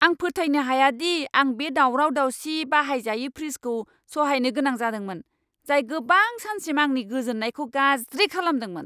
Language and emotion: Bodo, angry